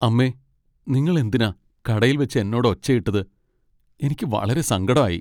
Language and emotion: Malayalam, sad